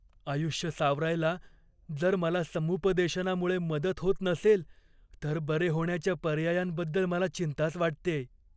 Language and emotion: Marathi, fearful